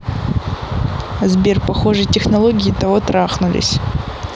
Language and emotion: Russian, neutral